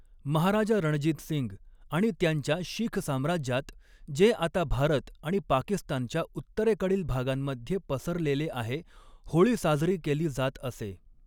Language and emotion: Marathi, neutral